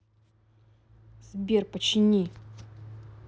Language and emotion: Russian, neutral